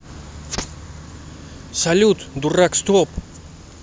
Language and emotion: Russian, angry